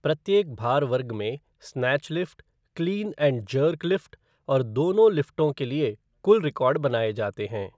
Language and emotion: Hindi, neutral